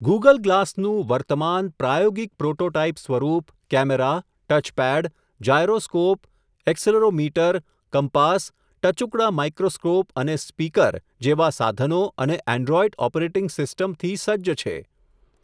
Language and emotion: Gujarati, neutral